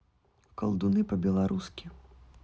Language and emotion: Russian, neutral